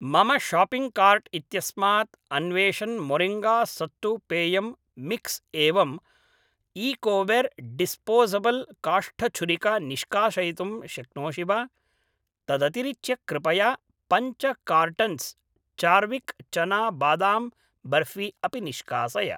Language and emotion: Sanskrit, neutral